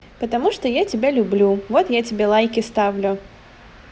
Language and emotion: Russian, positive